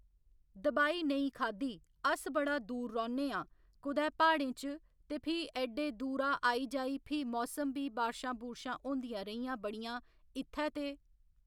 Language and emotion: Dogri, neutral